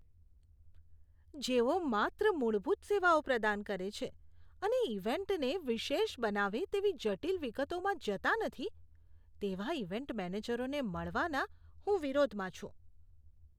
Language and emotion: Gujarati, disgusted